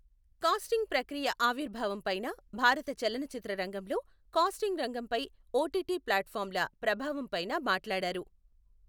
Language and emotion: Telugu, neutral